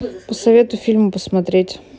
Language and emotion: Russian, neutral